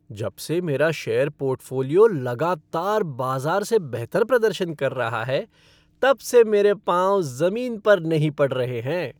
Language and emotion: Hindi, happy